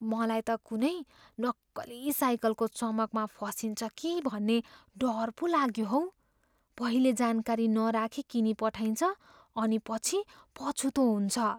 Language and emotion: Nepali, fearful